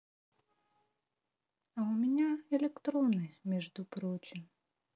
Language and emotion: Russian, neutral